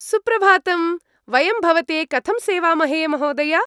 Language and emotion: Sanskrit, happy